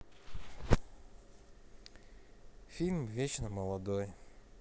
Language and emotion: Russian, neutral